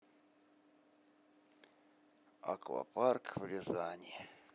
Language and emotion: Russian, sad